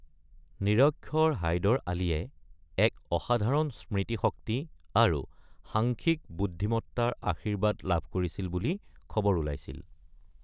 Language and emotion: Assamese, neutral